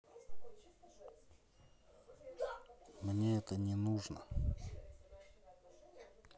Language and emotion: Russian, sad